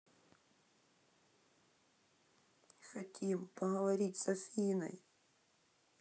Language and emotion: Russian, sad